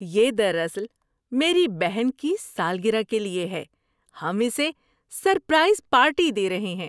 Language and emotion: Urdu, happy